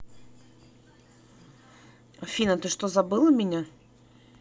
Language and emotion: Russian, neutral